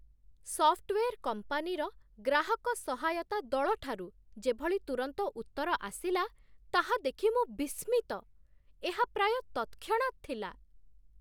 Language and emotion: Odia, surprised